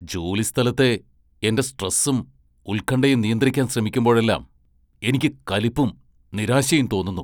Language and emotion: Malayalam, angry